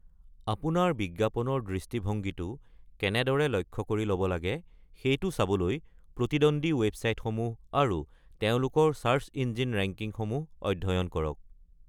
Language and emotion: Assamese, neutral